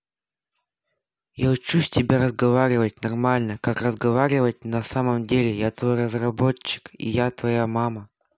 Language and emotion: Russian, neutral